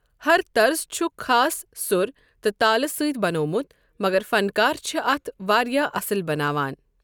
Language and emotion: Kashmiri, neutral